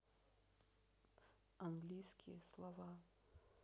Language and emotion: Russian, neutral